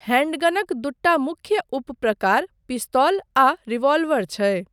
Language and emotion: Maithili, neutral